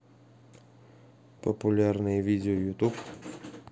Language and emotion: Russian, neutral